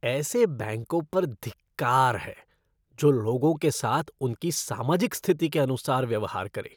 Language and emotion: Hindi, disgusted